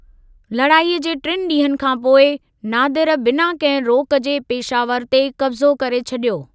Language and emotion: Sindhi, neutral